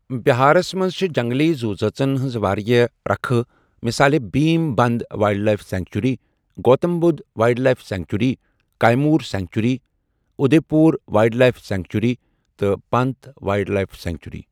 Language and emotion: Kashmiri, neutral